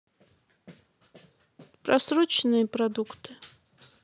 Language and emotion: Russian, neutral